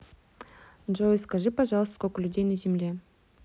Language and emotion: Russian, neutral